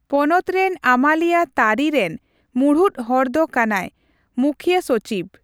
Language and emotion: Santali, neutral